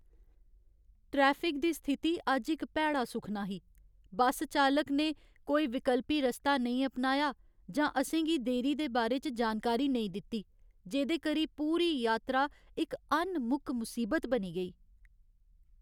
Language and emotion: Dogri, angry